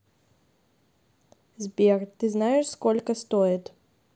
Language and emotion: Russian, neutral